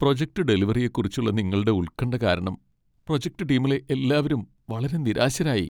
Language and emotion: Malayalam, sad